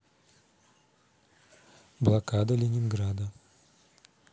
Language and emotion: Russian, neutral